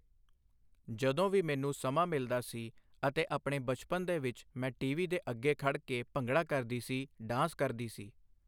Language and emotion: Punjabi, neutral